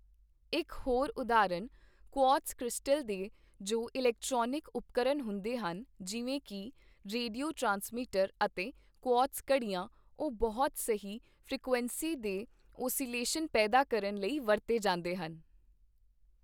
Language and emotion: Punjabi, neutral